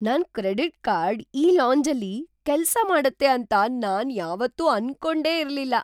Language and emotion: Kannada, surprised